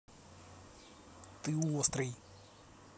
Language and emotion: Russian, neutral